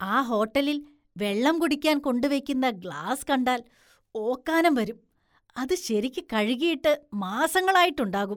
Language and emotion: Malayalam, disgusted